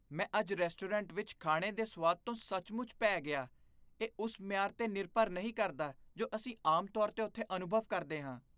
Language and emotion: Punjabi, disgusted